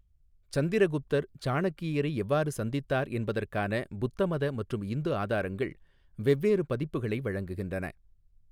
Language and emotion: Tamil, neutral